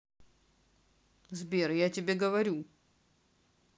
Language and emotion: Russian, neutral